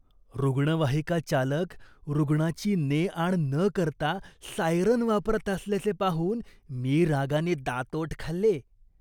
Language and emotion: Marathi, disgusted